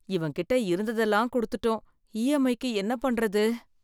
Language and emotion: Tamil, fearful